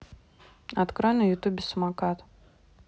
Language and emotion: Russian, neutral